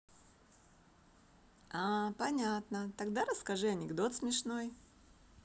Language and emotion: Russian, positive